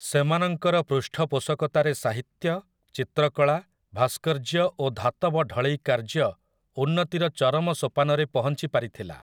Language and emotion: Odia, neutral